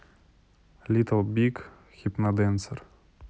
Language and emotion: Russian, neutral